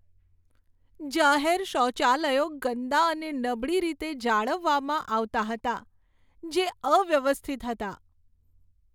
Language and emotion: Gujarati, sad